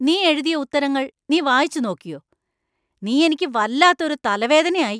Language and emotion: Malayalam, angry